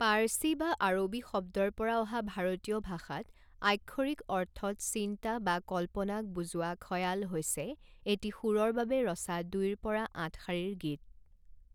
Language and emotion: Assamese, neutral